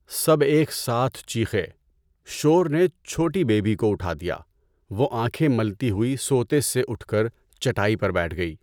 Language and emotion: Urdu, neutral